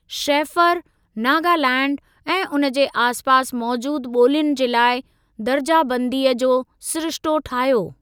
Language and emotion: Sindhi, neutral